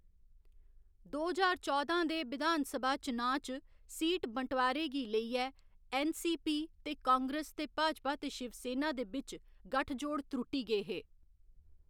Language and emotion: Dogri, neutral